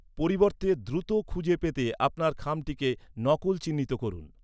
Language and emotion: Bengali, neutral